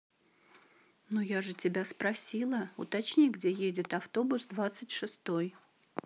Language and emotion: Russian, neutral